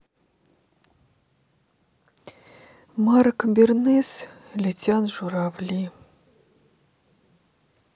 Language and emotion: Russian, sad